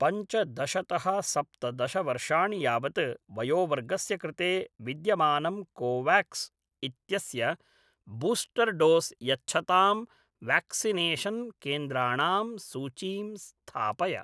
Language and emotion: Sanskrit, neutral